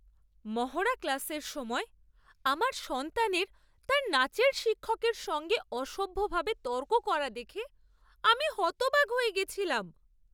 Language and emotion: Bengali, surprised